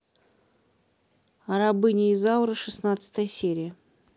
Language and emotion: Russian, neutral